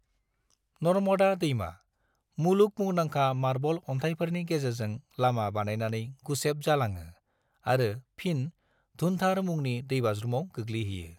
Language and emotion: Bodo, neutral